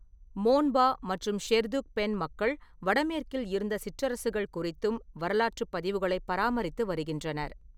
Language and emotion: Tamil, neutral